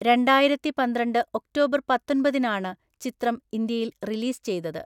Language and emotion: Malayalam, neutral